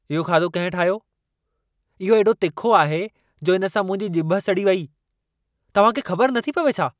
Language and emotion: Sindhi, angry